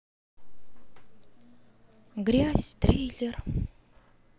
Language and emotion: Russian, sad